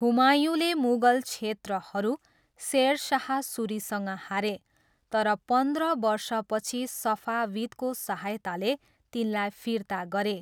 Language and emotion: Nepali, neutral